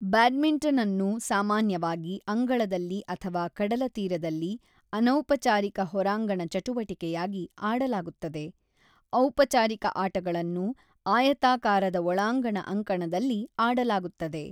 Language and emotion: Kannada, neutral